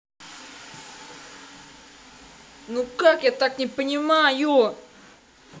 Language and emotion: Russian, angry